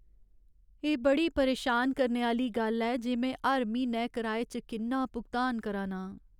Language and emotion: Dogri, sad